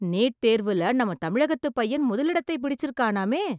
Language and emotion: Tamil, surprised